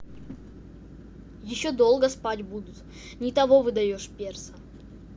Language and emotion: Russian, neutral